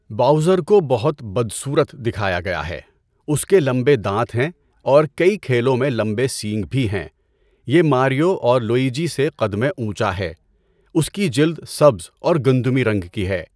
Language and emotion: Urdu, neutral